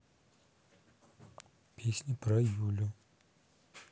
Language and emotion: Russian, neutral